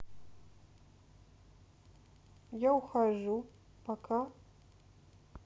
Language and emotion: Russian, sad